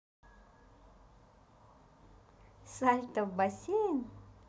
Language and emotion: Russian, positive